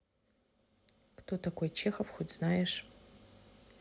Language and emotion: Russian, neutral